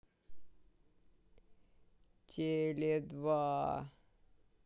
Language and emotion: Russian, neutral